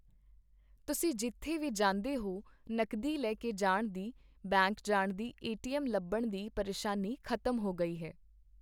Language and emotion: Punjabi, neutral